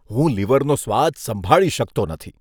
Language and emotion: Gujarati, disgusted